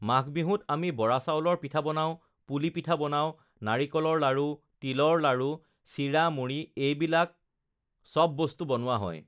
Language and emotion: Assamese, neutral